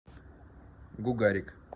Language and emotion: Russian, neutral